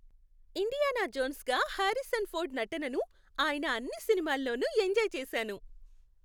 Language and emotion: Telugu, happy